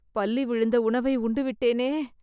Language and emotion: Tamil, fearful